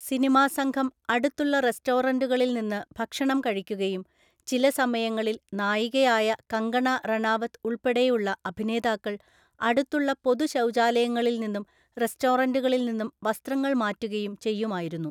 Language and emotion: Malayalam, neutral